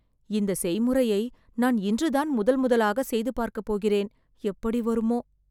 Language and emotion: Tamil, fearful